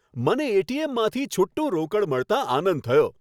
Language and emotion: Gujarati, happy